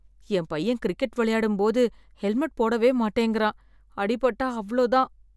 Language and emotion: Tamil, fearful